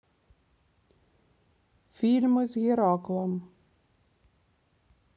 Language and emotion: Russian, neutral